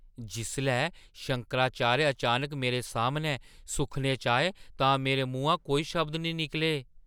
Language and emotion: Dogri, surprised